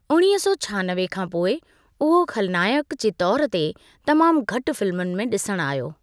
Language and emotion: Sindhi, neutral